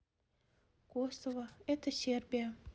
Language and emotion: Russian, neutral